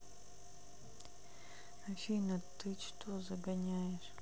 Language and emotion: Russian, sad